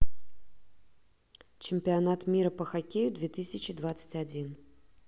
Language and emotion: Russian, neutral